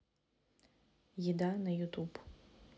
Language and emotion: Russian, neutral